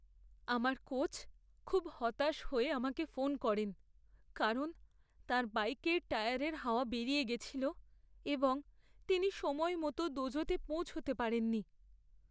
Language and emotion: Bengali, sad